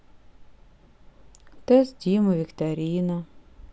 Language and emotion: Russian, sad